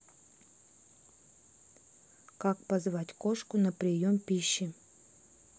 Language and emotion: Russian, neutral